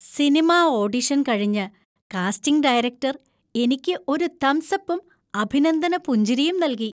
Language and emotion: Malayalam, happy